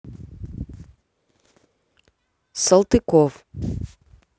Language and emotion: Russian, neutral